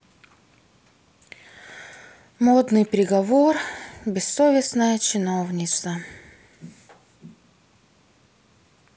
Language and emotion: Russian, sad